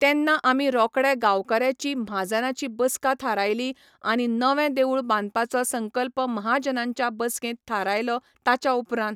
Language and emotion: Goan Konkani, neutral